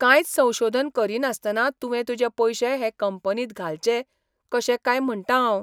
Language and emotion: Goan Konkani, surprised